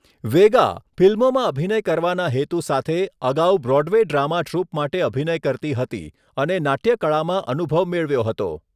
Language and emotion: Gujarati, neutral